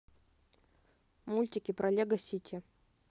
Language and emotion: Russian, neutral